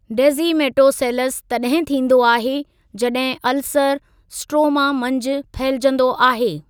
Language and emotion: Sindhi, neutral